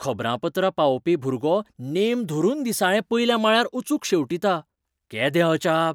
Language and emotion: Goan Konkani, surprised